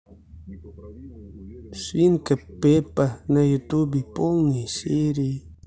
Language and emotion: Russian, sad